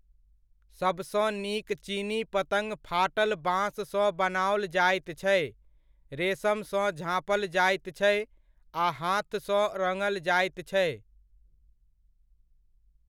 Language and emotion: Maithili, neutral